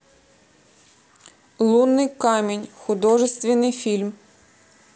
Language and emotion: Russian, neutral